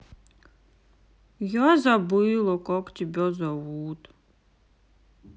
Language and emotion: Russian, sad